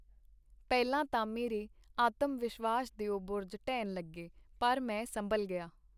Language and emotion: Punjabi, neutral